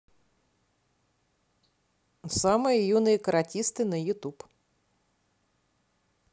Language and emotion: Russian, neutral